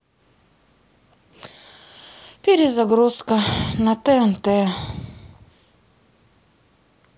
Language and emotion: Russian, sad